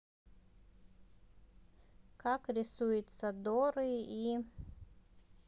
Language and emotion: Russian, neutral